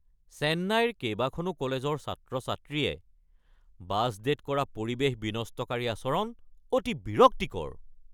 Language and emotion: Assamese, angry